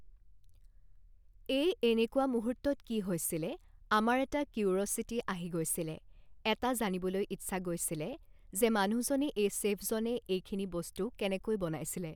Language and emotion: Assamese, neutral